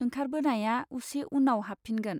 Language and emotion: Bodo, neutral